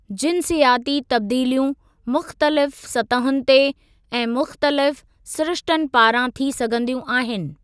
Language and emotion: Sindhi, neutral